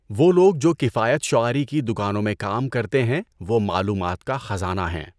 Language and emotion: Urdu, neutral